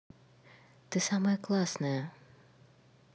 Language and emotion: Russian, positive